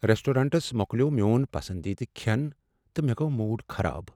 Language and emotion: Kashmiri, sad